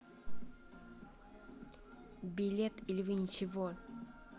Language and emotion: Russian, neutral